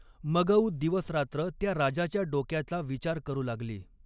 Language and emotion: Marathi, neutral